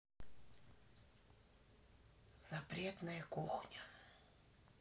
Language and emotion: Russian, sad